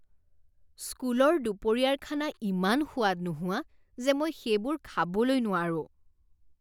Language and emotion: Assamese, disgusted